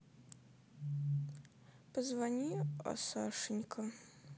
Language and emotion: Russian, sad